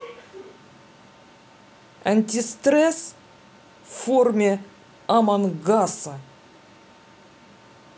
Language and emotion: Russian, neutral